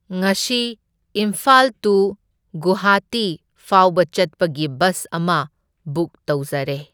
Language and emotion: Manipuri, neutral